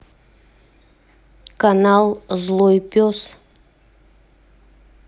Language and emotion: Russian, neutral